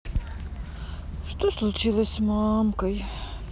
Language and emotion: Russian, sad